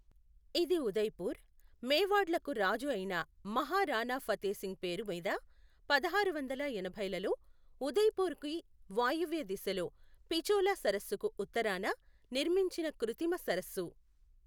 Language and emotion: Telugu, neutral